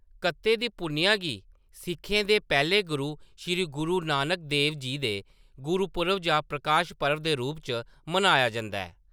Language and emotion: Dogri, neutral